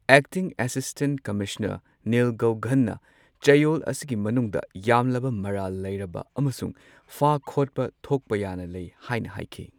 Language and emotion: Manipuri, neutral